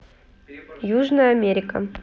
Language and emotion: Russian, neutral